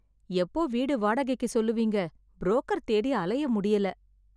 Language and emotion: Tamil, sad